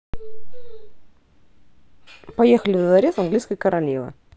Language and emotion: Russian, positive